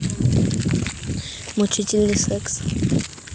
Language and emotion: Russian, neutral